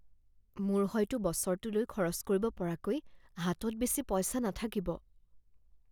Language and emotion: Assamese, fearful